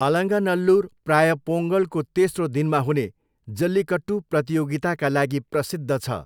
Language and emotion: Nepali, neutral